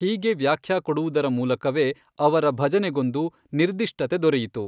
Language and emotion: Kannada, neutral